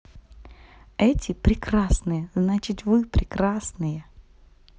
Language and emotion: Russian, positive